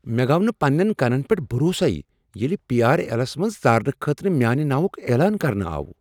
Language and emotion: Kashmiri, surprised